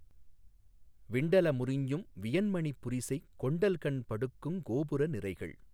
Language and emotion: Tamil, neutral